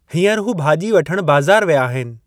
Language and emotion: Sindhi, neutral